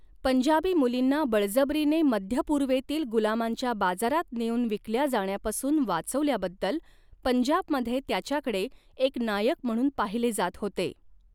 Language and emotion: Marathi, neutral